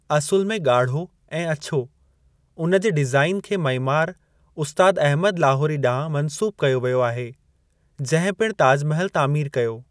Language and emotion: Sindhi, neutral